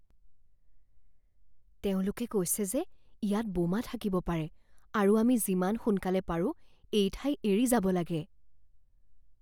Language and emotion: Assamese, fearful